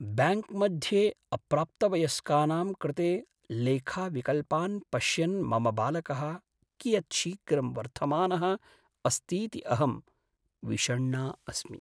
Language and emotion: Sanskrit, sad